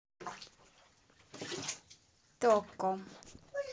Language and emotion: Russian, neutral